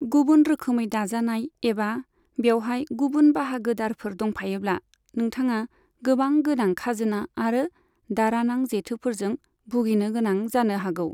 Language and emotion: Bodo, neutral